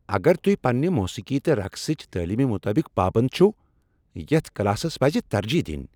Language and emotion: Kashmiri, angry